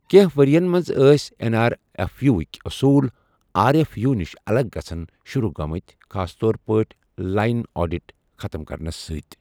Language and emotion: Kashmiri, neutral